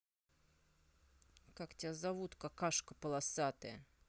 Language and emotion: Russian, angry